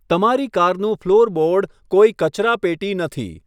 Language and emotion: Gujarati, neutral